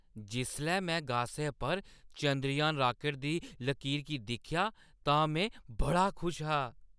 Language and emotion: Dogri, happy